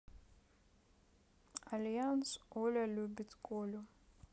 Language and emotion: Russian, neutral